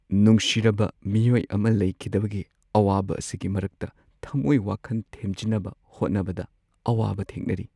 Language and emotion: Manipuri, sad